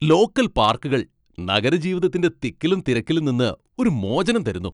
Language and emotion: Malayalam, happy